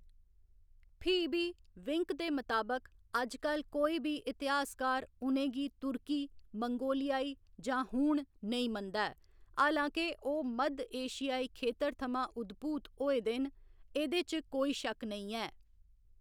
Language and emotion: Dogri, neutral